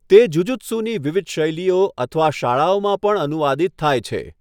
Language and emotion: Gujarati, neutral